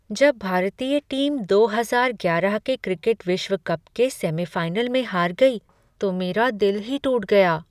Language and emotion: Hindi, sad